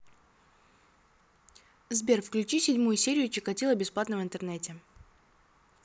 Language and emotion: Russian, neutral